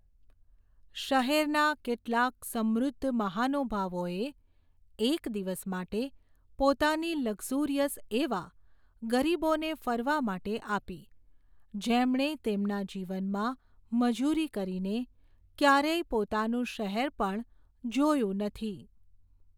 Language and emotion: Gujarati, neutral